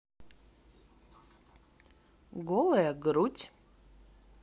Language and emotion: Russian, neutral